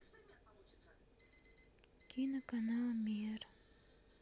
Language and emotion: Russian, sad